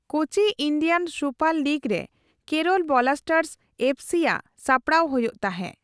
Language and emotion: Santali, neutral